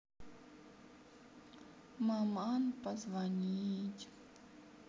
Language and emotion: Russian, sad